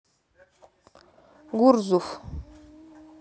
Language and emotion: Russian, neutral